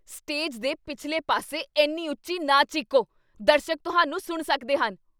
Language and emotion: Punjabi, angry